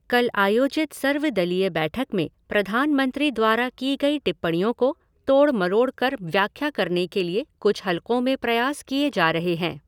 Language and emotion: Hindi, neutral